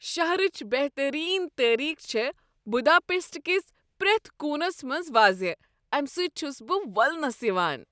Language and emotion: Kashmiri, happy